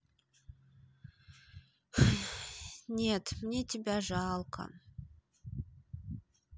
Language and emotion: Russian, sad